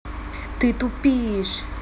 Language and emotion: Russian, angry